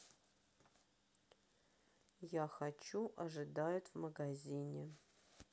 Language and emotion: Russian, neutral